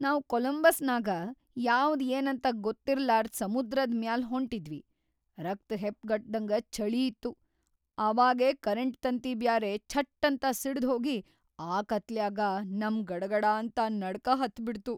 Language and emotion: Kannada, fearful